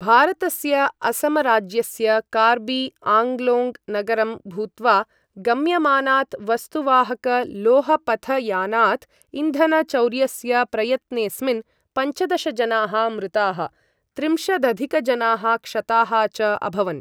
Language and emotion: Sanskrit, neutral